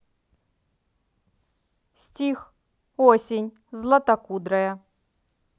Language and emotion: Russian, neutral